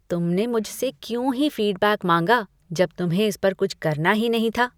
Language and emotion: Hindi, disgusted